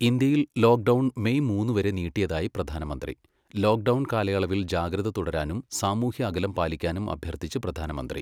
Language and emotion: Malayalam, neutral